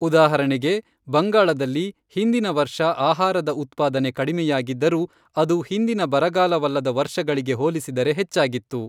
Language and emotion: Kannada, neutral